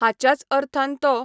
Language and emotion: Goan Konkani, neutral